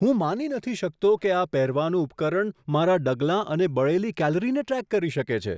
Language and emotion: Gujarati, surprised